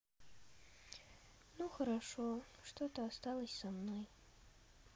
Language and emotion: Russian, neutral